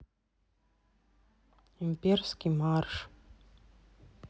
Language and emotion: Russian, sad